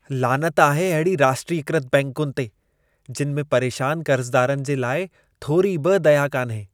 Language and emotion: Sindhi, disgusted